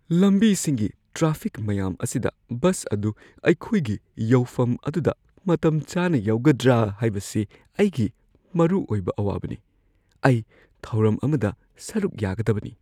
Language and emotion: Manipuri, fearful